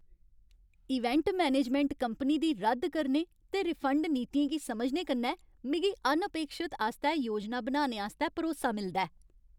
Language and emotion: Dogri, happy